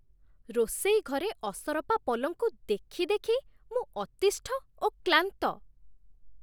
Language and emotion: Odia, disgusted